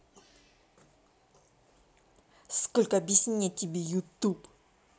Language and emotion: Russian, angry